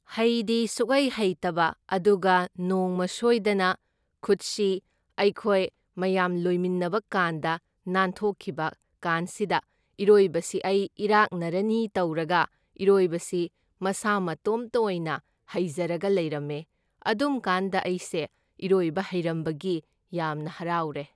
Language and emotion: Manipuri, neutral